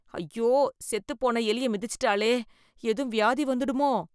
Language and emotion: Tamil, disgusted